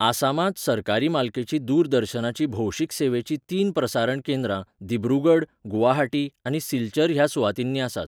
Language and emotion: Goan Konkani, neutral